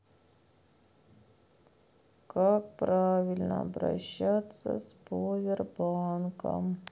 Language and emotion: Russian, sad